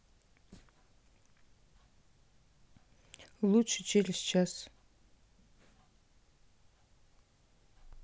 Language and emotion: Russian, neutral